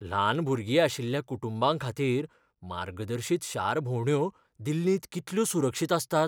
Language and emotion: Goan Konkani, fearful